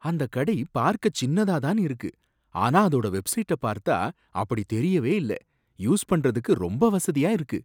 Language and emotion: Tamil, surprised